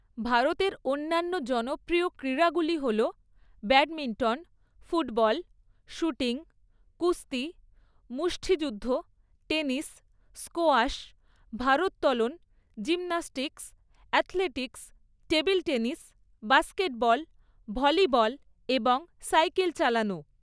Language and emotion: Bengali, neutral